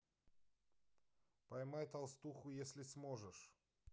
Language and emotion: Russian, neutral